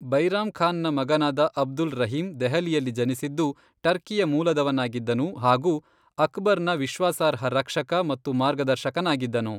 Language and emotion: Kannada, neutral